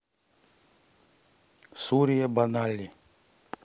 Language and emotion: Russian, neutral